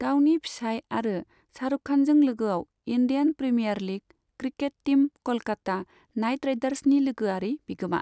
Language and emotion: Bodo, neutral